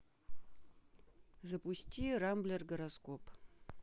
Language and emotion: Russian, neutral